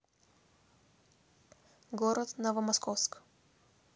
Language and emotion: Russian, neutral